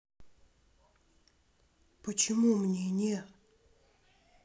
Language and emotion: Russian, neutral